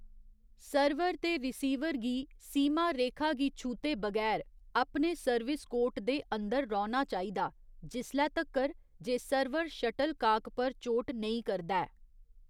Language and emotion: Dogri, neutral